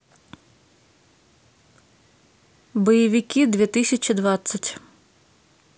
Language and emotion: Russian, neutral